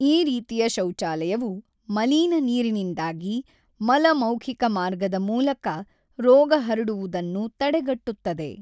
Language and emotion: Kannada, neutral